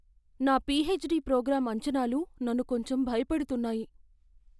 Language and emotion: Telugu, fearful